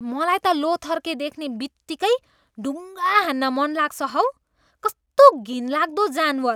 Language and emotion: Nepali, disgusted